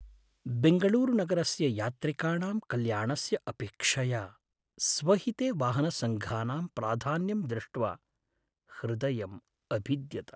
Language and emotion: Sanskrit, sad